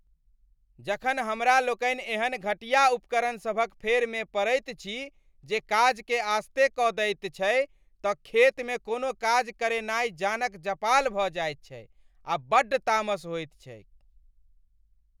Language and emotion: Maithili, angry